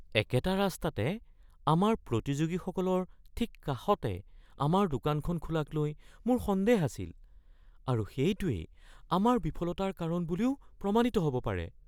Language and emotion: Assamese, fearful